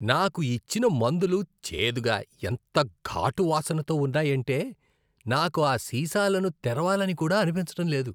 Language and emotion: Telugu, disgusted